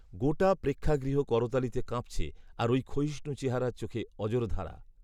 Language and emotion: Bengali, neutral